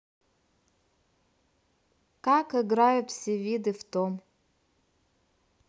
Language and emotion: Russian, neutral